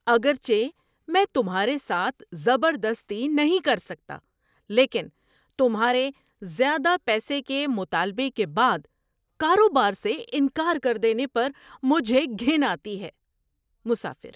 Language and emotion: Urdu, surprised